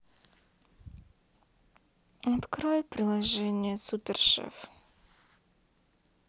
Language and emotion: Russian, sad